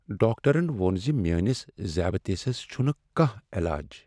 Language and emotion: Kashmiri, sad